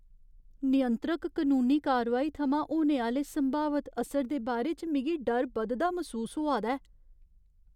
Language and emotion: Dogri, fearful